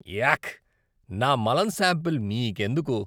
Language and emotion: Telugu, disgusted